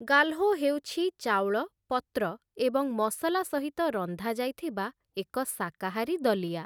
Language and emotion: Odia, neutral